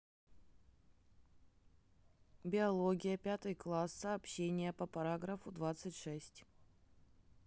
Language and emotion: Russian, neutral